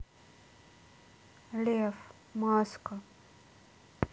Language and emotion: Russian, neutral